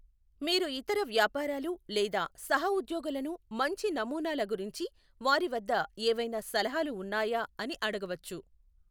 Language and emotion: Telugu, neutral